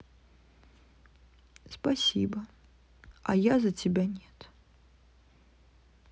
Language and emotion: Russian, sad